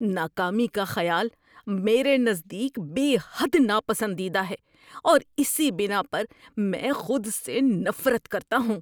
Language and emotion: Urdu, disgusted